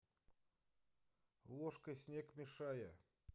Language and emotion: Russian, neutral